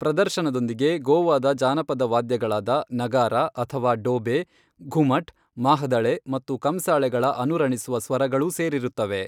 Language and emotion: Kannada, neutral